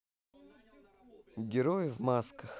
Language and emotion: Russian, neutral